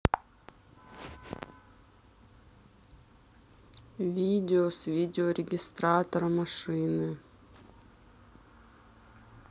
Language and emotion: Russian, sad